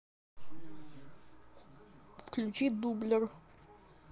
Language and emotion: Russian, neutral